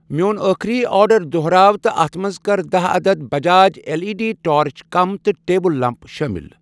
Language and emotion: Kashmiri, neutral